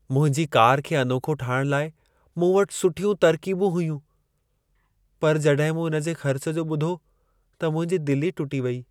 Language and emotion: Sindhi, sad